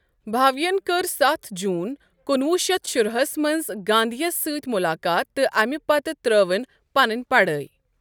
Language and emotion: Kashmiri, neutral